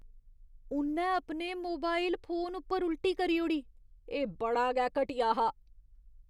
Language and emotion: Dogri, disgusted